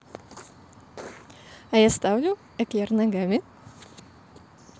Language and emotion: Russian, positive